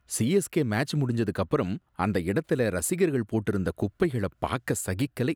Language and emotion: Tamil, disgusted